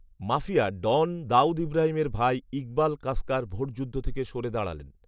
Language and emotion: Bengali, neutral